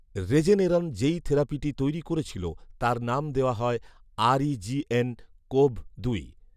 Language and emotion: Bengali, neutral